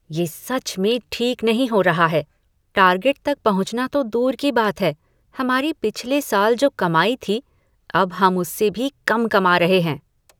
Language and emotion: Hindi, disgusted